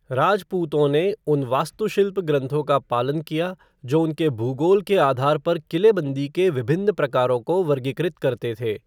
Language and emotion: Hindi, neutral